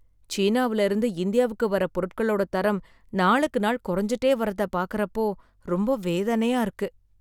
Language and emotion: Tamil, sad